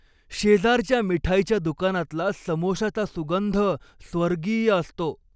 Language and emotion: Marathi, happy